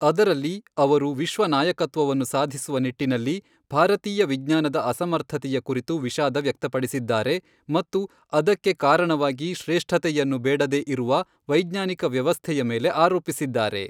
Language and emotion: Kannada, neutral